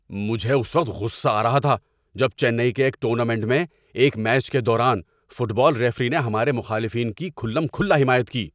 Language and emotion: Urdu, angry